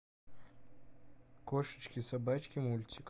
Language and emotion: Russian, neutral